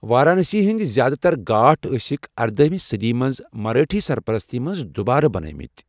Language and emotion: Kashmiri, neutral